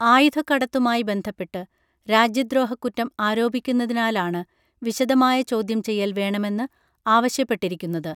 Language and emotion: Malayalam, neutral